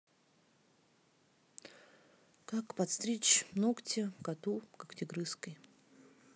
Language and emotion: Russian, neutral